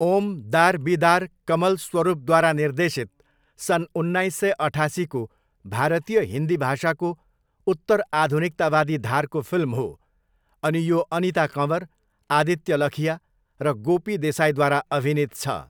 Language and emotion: Nepali, neutral